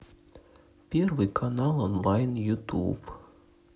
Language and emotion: Russian, sad